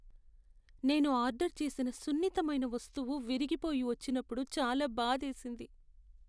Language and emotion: Telugu, sad